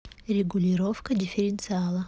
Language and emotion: Russian, neutral